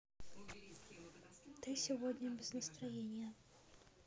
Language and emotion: Russian, sad